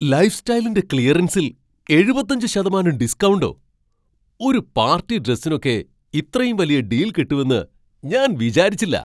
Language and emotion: Malayalam, surprised